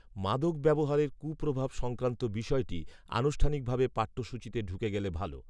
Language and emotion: Bengali, neutral